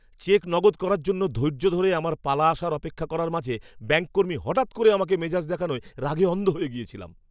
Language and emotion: Bengali, angry